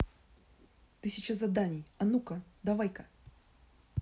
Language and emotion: Russian, angry